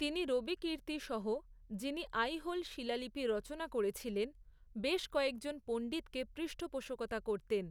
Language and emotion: Bengali, neutral